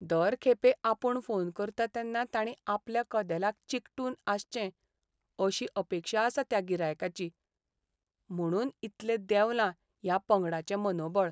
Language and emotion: Goan Konkani, sad